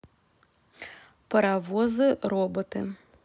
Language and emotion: Russian, neutral